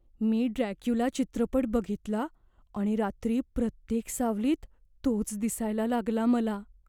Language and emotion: Marathi, fearful